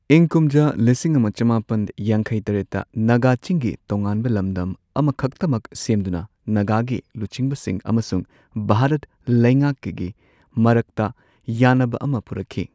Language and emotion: Manipuri, neutral